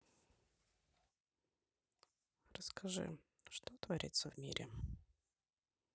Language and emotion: Russian, neutral